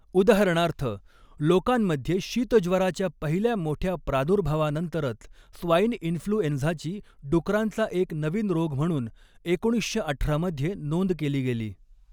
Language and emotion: Marathi, neutral